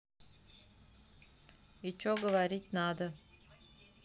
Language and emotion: Russian, neutral